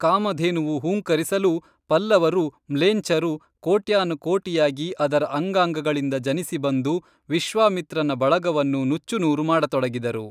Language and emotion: Kannada, neutral